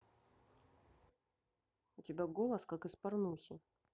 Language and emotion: Russian, neutral